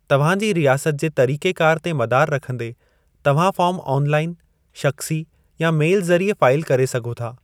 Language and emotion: Sindhi, neutral